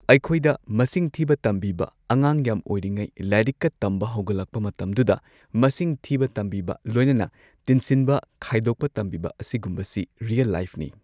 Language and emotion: Manipuri, neutral